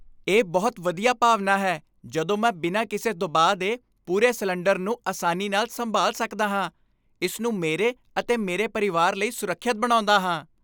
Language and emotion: Punjabi, happy